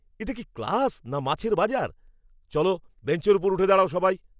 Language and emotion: Bengali, angry